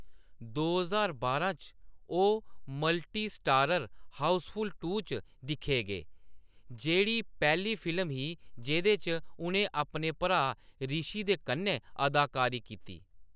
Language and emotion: Dogri, neutral